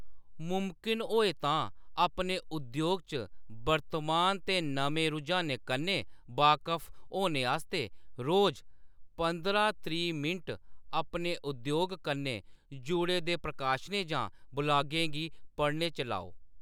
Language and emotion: Dogri, neutral